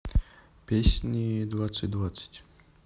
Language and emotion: Russian, neutral